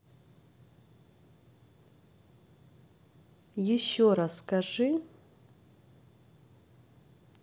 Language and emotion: Russian, neutral